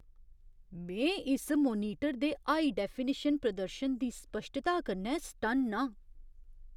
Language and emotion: Dogri, surprised